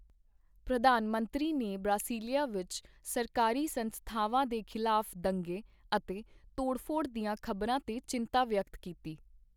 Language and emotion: Punjabi, neutral